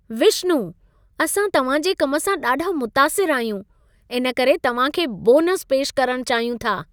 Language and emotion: Sindhi, happy